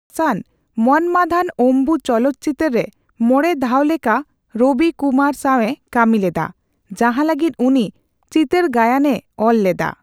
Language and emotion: Santali, neutral